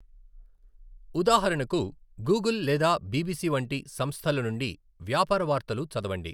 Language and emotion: Telugu, neutral